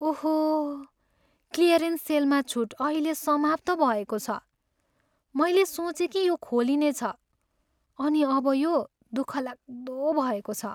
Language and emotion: Nepali, sad